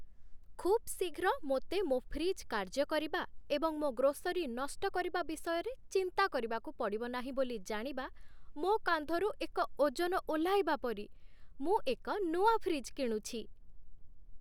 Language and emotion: Odia, happy